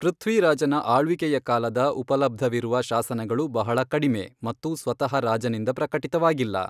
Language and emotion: Kannada, neutral